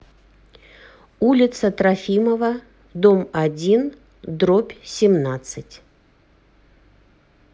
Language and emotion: Russian, neutral